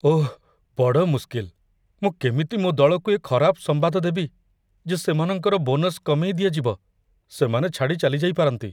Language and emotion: Odia, fearful